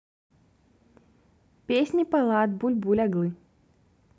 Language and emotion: Russian, neutral